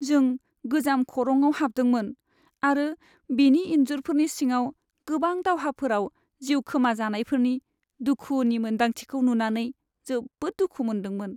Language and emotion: Bodo, sad